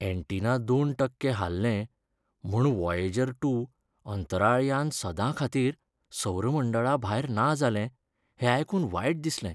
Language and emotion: Goan Konkani, sad